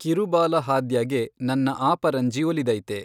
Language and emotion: Kannada, neutral